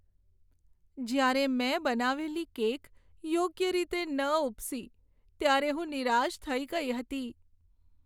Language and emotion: Gujarati, sad